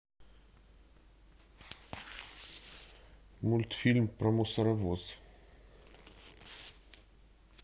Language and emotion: Russian, neutral